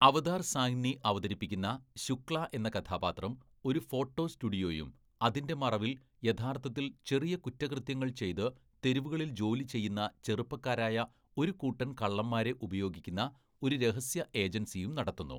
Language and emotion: Malayalam, neutral